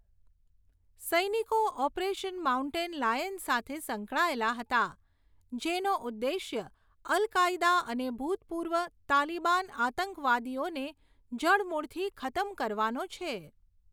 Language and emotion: Gujarati, neutral